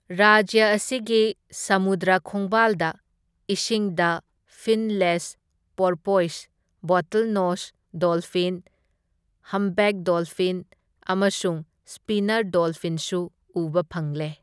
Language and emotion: Manipuri, neutral